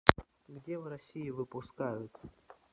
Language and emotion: Russian, neutral